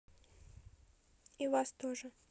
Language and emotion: Russian, neutral